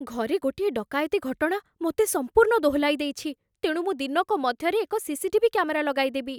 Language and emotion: Odia, fearful